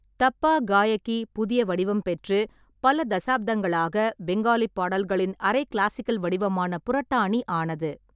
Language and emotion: Tamil, neutral